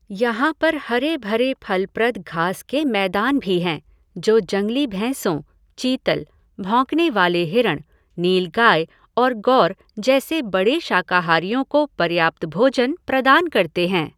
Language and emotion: Hindi, neutral